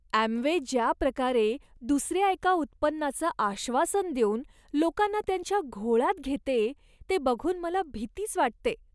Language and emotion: Marathi, disgusted